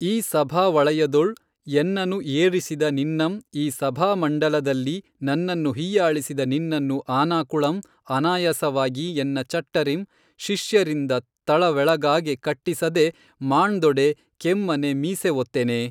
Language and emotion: Kannada, neutral